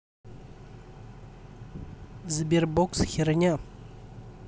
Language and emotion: Russian, neutral